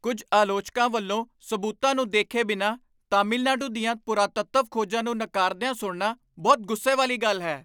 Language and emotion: Punjabi, angry